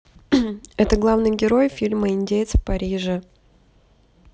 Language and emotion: Russian, neutral